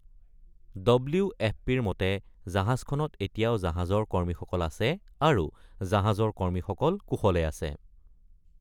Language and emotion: Assamese, neutral